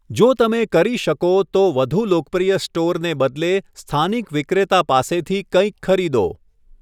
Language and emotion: Gujarati, neutral